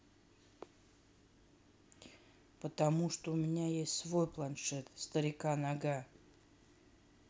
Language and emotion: Russian, neutral